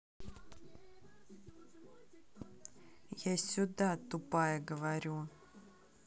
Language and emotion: Russian, angry